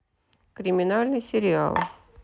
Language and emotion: Russian, neutral